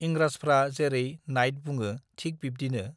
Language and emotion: Bodo, neutral